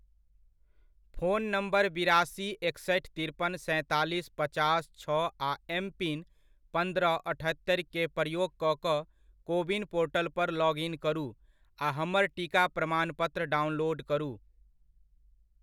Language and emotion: Maithili, neutral